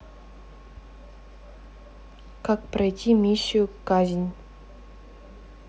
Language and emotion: Russian, neutral